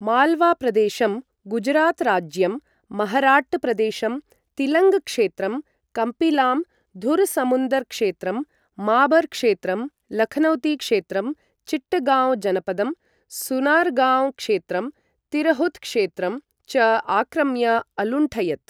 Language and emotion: Sanskrit, neutral